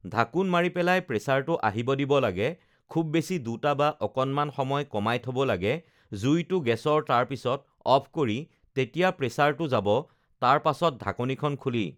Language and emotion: Assamese, neutral